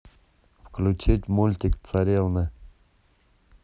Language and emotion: Russian, neutral